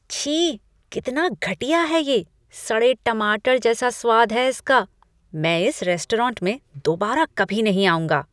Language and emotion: Hindi, disgusted